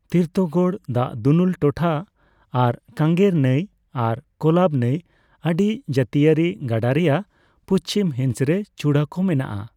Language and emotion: Santali, neutral